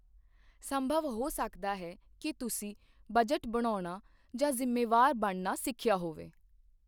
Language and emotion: Punjabi, neutral